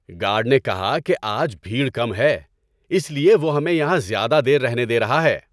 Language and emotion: Urdu, happy